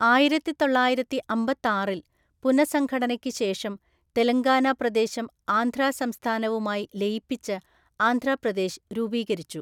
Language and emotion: Malayalam, neutral